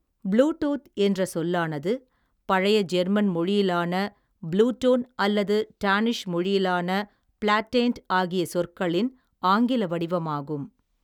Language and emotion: Tamil, neutral